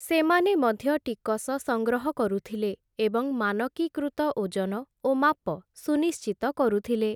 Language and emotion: Odia, neutral